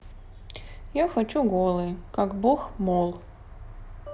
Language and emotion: Russian, sad